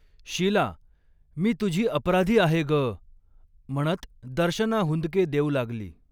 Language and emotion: Marathi, neutral